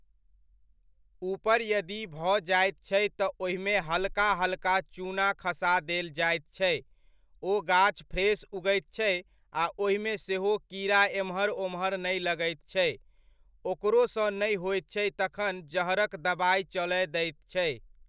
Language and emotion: Maithili, neutral